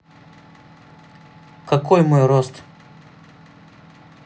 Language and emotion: Russian, neutral